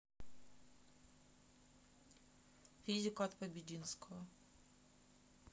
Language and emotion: Russian, neutral